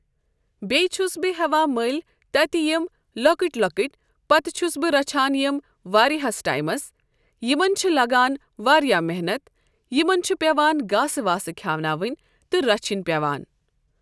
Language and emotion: Kashmiri, neutral